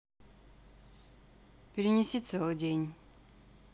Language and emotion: Russian, neutral